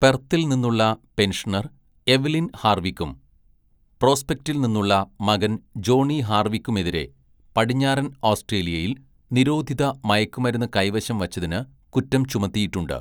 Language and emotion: Malayalam, neutral